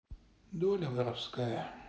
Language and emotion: Russian, sad